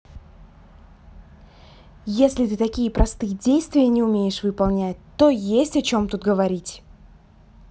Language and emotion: Russian, angry